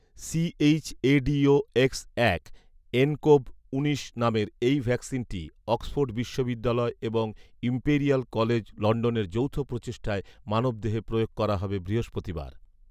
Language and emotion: Bengali, neutral